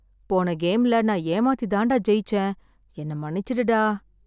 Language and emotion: Tamil, sad